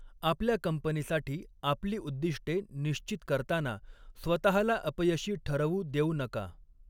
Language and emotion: Marathi, neutral